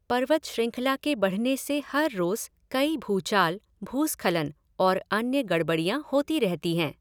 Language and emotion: Hindi, neutral